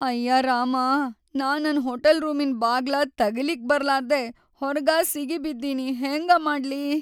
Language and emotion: Kannada, sad